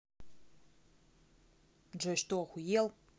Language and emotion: Russian, angry